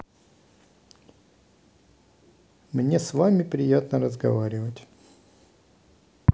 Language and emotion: Russian, neutral